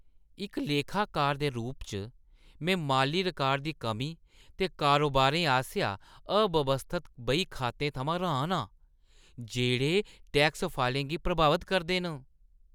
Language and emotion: Dogri, disgusted